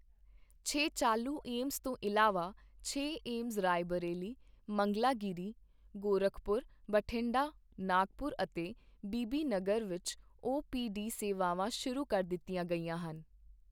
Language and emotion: Punjabi, neutral